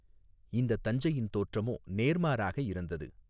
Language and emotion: Tamil, neutral